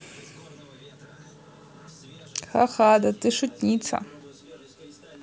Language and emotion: Russian, neutral